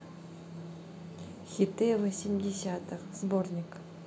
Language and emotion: Russian, neutral